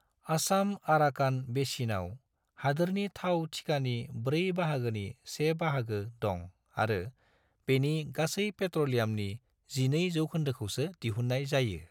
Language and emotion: Bodo, neutral